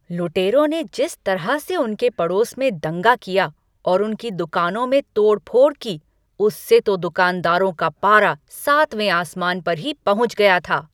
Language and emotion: Hindi, angry